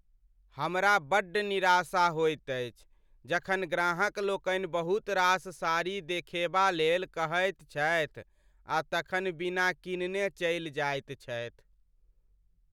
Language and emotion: Maithili, sad